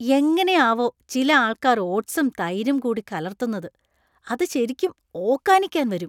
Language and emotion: Malayalam, disgusted